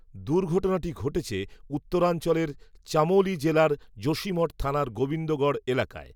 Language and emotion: Bengali, neutral